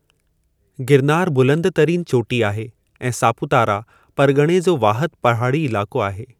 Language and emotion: Sindhi, neutral